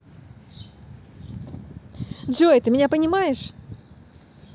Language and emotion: Russian, positive